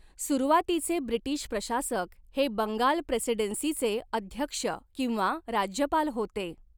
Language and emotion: Marathi, neutral